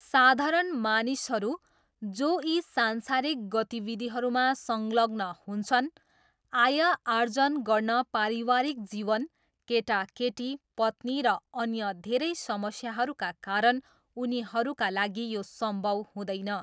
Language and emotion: Nepali, neutral